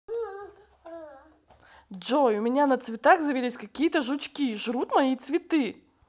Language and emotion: Russian, angry